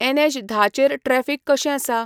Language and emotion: Goan Konkani, neutral